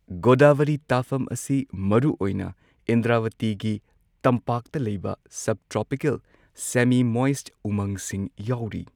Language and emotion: Manipuri, neutral